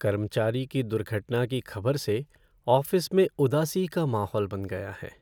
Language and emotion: Hindi, sad